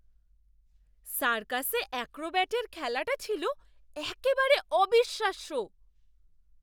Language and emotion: Bengali, surprised